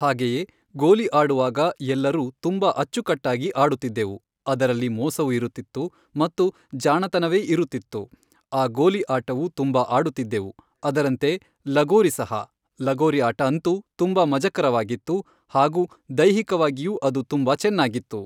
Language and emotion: Kannada, neutral